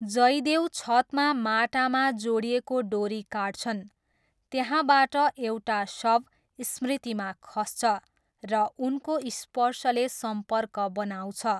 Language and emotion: Nepali, neutral